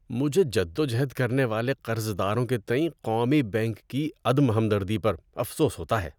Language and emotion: Urdu, disgusted